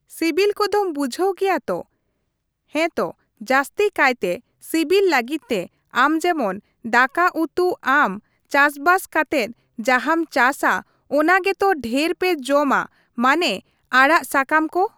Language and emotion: Santali, neutral